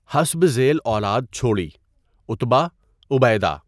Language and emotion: Urdu, neutral